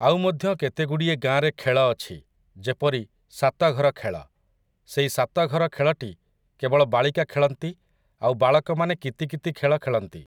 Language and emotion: Odia, neutral